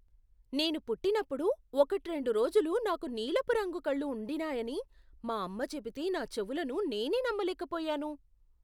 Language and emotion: Telugu, surprised